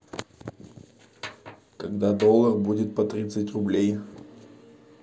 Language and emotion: Russian, neutral